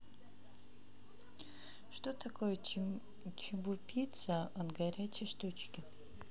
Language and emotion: Russian, neutral